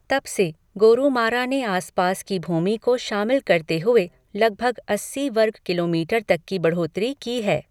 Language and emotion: Hindi, neutral